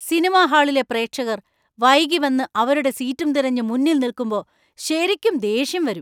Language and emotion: Malayalam, angry